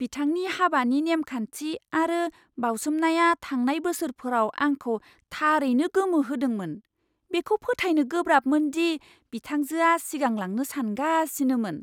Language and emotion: Bodo, surprised